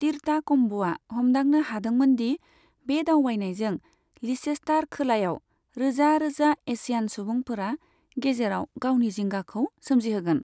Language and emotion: Bodo, neutral